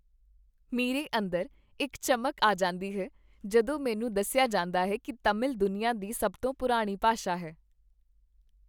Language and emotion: Punjabi, happy